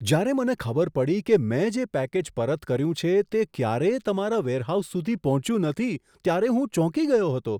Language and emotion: Gujarati, surprised